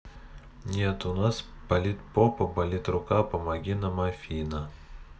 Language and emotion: Russian, neutral